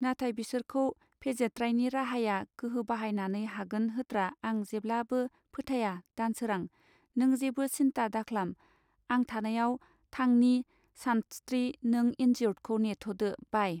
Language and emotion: Bodo, neutral